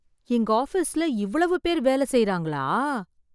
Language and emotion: Tamil, surprised